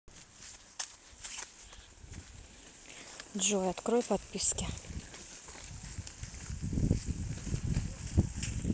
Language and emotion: Russian, neutral